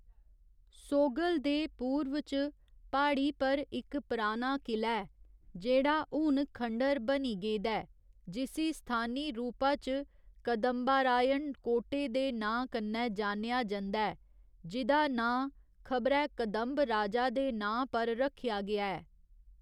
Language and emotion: Dogri, neutral